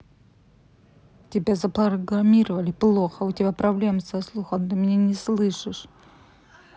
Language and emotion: Russian, angry